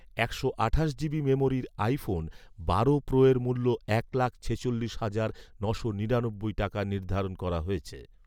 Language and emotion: Bengali, neutral